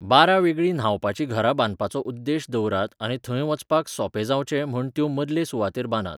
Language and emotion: Goan Konkani, neutral